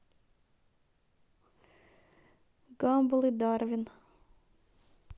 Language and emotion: Russian, neutral